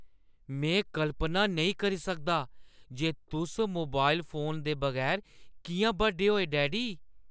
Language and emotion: Dogri, surprised